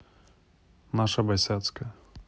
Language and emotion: Russian, neutral